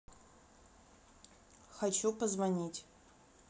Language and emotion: Russian, neutral